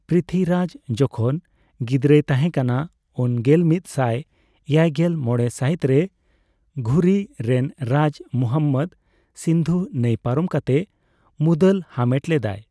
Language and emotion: Santali, neutral